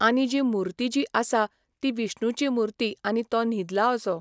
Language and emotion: Goan Konkani, neutral